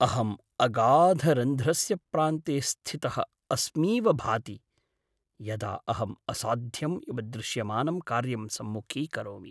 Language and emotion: Sanskrit, sad